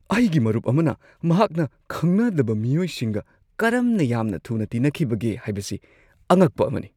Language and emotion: Manipuri, surprised